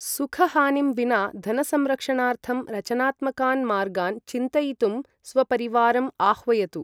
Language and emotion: Sanskrit, neutral